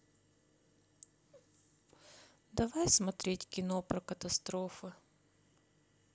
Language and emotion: Russian, sad